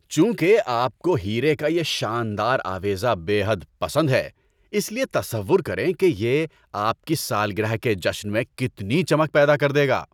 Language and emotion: Urdu, happy